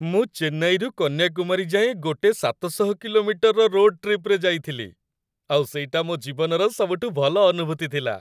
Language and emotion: Odia, happy